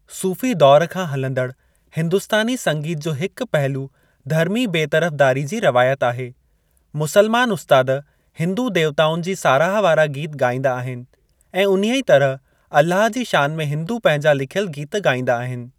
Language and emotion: Sindhi, neutral